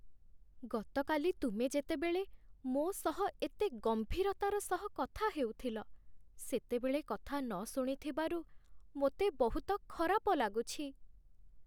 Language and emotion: Odia, sad